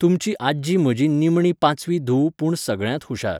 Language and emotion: Goan Konkani, neutral